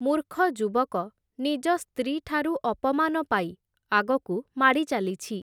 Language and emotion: Odia, neutral